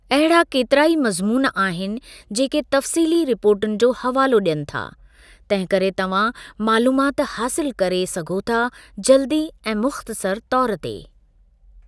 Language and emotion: Sindhi, neutral